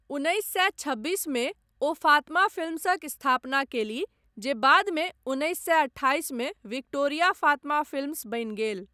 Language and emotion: Maithili, neutral